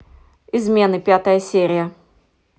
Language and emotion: Russian, neutral